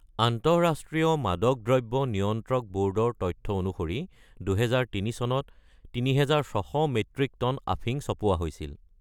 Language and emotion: Assamese, neutral